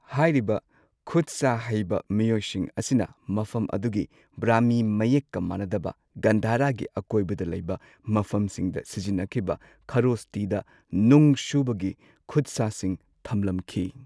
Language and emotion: Manipuri, neutral